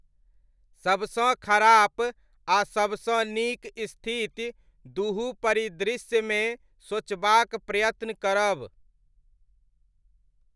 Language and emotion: Maithili, neutral